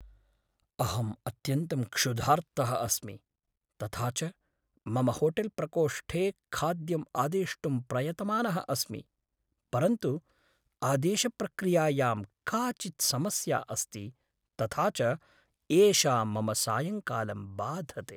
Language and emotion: Sanskrit, sad